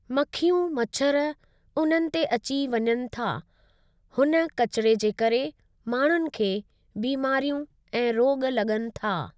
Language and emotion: Sindhi, neutral